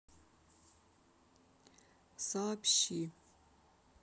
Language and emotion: Russian, neutral